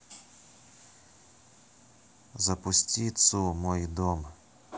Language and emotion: Russian, neutral